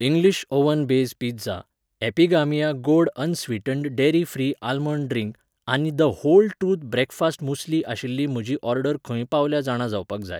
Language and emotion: Goan Konkani, neutral